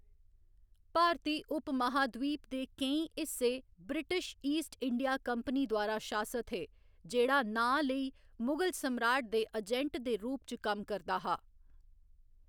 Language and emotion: Dogri, neutral